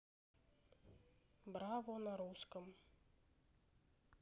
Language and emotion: Russian, neutral